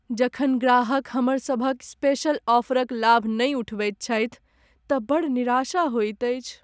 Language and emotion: Maithili, sad